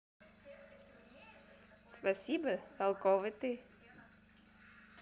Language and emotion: Russian, positive